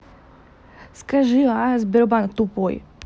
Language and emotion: Russian, angry